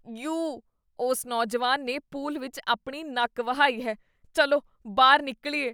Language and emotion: Punjabi, disgusted